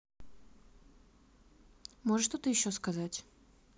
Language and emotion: Russian, neutral